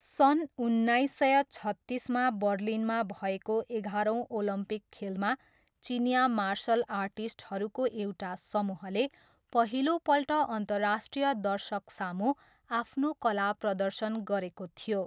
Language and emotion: Nepali, neutral